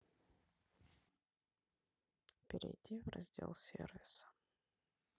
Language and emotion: Russian, neutral